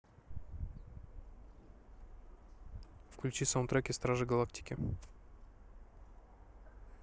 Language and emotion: Russian, neutral